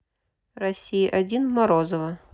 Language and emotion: Russian, neutral